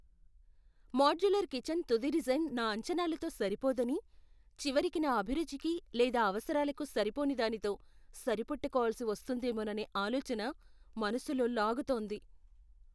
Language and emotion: Telugu, fearful